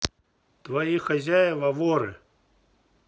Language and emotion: Russian, neutral